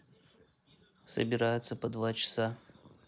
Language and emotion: Russian, neutral